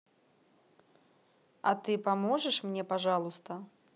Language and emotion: Russian, neutral